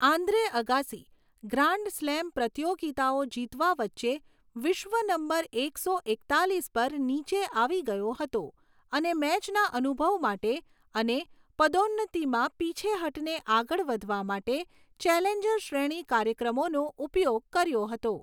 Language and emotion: Gujarati, neutral